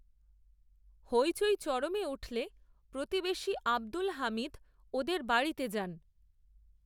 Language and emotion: Bengali, neutral